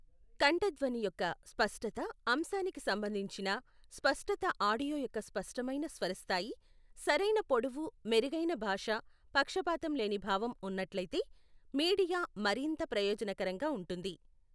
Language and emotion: Telugu, neutral